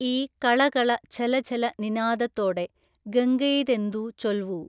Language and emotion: Malayalam, neutral